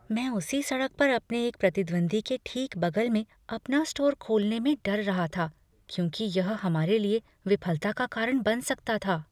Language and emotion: Hindi, fearful